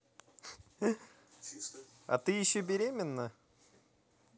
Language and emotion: Russian, positive